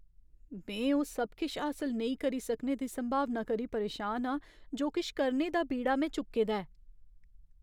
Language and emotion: Dogri, fearful